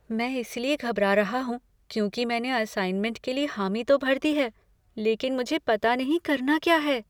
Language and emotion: Hindi, fearful